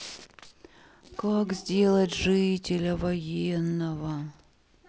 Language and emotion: Russian, sad